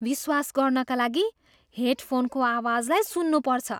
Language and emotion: Nepali, surprised